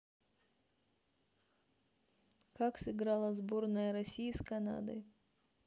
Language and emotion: Russian, neutral